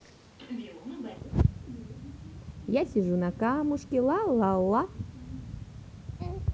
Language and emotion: Russian, positive